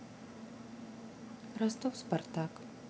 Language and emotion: Russian, neutral